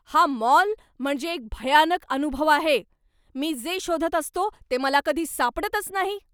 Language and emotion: Marathi, angry